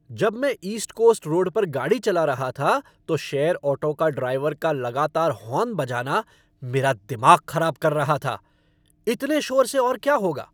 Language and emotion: Hindi, angry